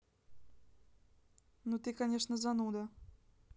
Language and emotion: Russian, neutral